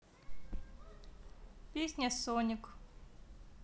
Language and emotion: Russian, neutral